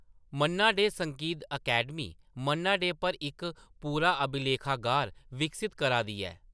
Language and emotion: Dogri, neutral